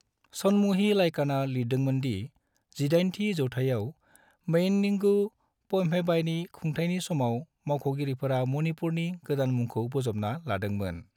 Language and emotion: Bodo, neutral